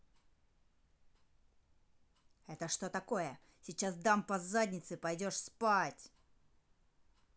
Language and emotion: Russian, angry